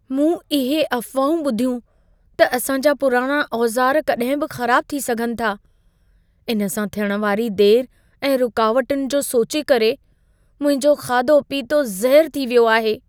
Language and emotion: Sindhi, fearful